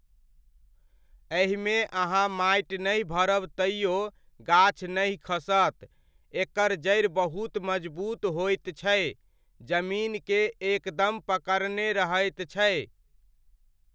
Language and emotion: Maithili, neutral